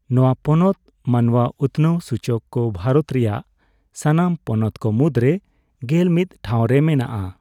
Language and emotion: Santali, neutral